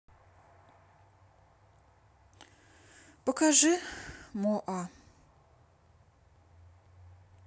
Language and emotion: Russian, sad